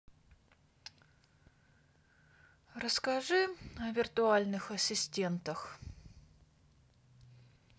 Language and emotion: Russian, sad